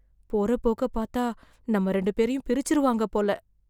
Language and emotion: Tamil, fearful